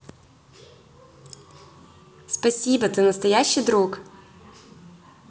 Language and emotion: Russian, positive